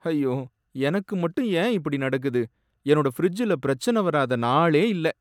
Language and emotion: Tamil, sad